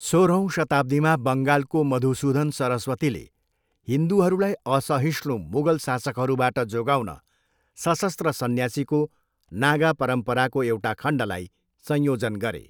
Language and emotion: Nepali, neutral